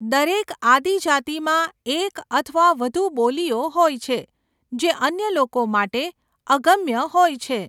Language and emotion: Gujarati, neutral